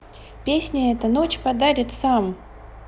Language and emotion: Russian, neutral